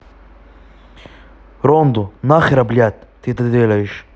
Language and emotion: Russian, angry